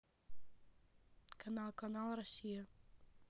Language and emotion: Russian, neutral